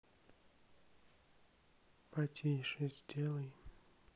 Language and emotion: Russian, sad